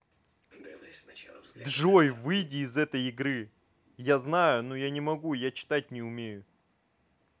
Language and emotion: Russian, angry